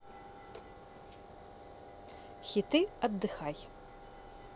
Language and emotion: Russian, positive